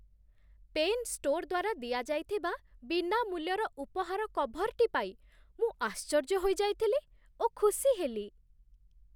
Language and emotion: Odia, surprised